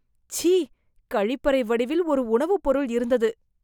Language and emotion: Tamil, disgusted